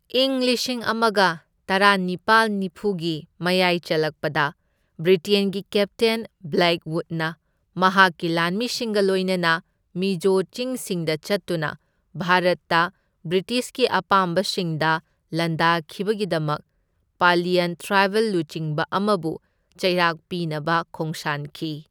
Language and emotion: Manipuri, neutral